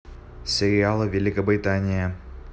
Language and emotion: Russian, neutral